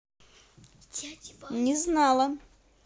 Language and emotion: Russian, positive